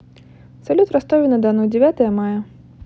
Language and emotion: Russian, neutral